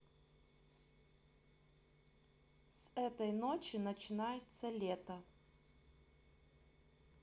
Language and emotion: Russian, neutral